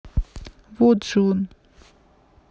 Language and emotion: Russian, neutral